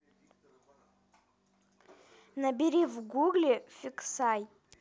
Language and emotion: Russian, neutral